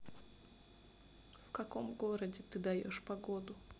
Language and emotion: Russian, neutral